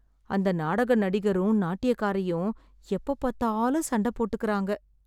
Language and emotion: Tamil, sad